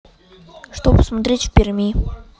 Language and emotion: Russian, neutral